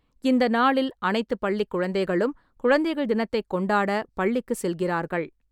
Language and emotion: Tamil, neutral